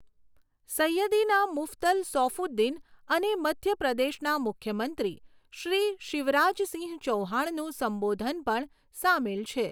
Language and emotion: Gujarati, neutral